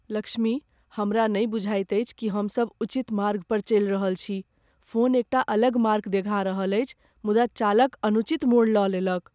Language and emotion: Maithili, fearful